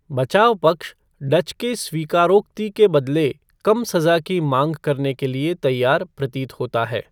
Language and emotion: Hindi, neutral